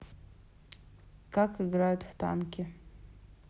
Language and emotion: Russian, neutral